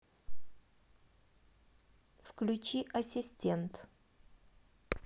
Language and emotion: Russian, neutral